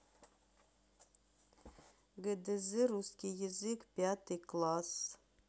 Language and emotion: Russian, neutral